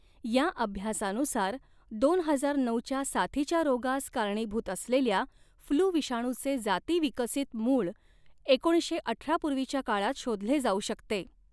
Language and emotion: Marathi, neutral